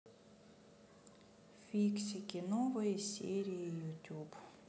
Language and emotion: Russian, sad